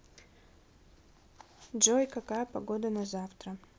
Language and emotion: Russian, neutral